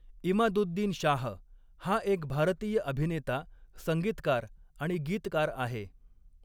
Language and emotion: Marathi, neutral